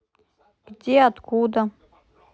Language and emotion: Russian, neutral